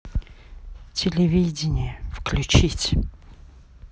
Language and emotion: Russian, neutral